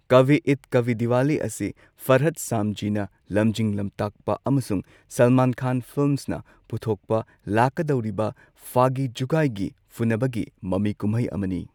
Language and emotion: Manipuri, neutral